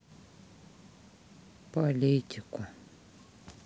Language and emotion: Russian, sad